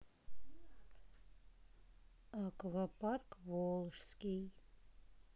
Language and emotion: Russian, neutral